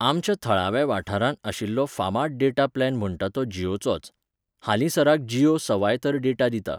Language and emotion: Goan Konkani, neutral